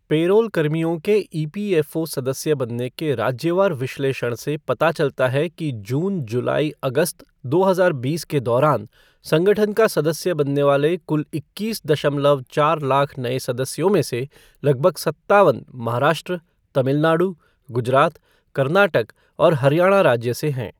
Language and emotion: Hindi, neutral